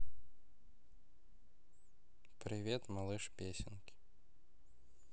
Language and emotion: Russian, neutral